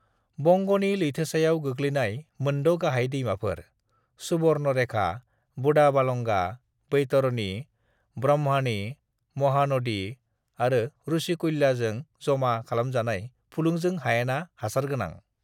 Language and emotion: Bodo, neutral